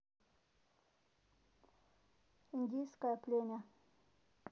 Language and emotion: Russian, neutral